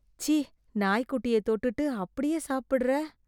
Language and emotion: Tamil, disgusted